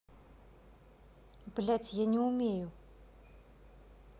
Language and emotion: Russian, angry